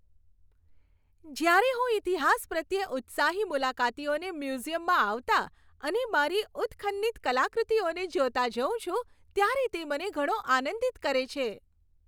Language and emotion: Gujarati, happy